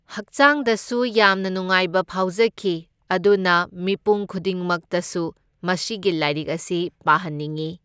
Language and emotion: Manipuri, neutral